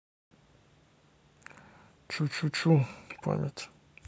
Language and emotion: Russian, neutral